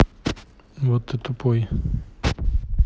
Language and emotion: Russian, neutral